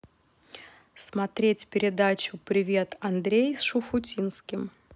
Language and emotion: Russian, neutral